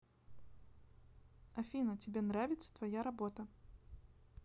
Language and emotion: Russian, neutral